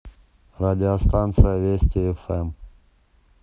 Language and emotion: Russian, neutral